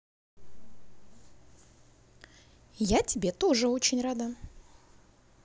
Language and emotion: Russian, positive